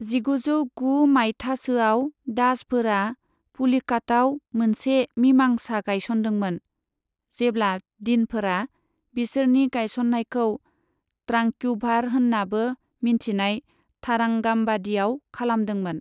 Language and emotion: Bodo, neutral